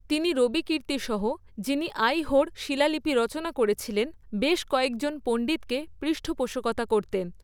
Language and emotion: Bengali, neutral